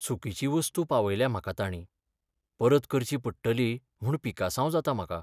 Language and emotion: Goan Konkani, sad